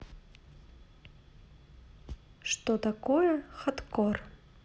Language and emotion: Russian, neutral